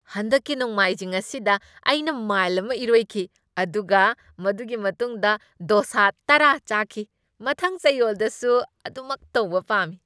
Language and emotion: Manipuri, happy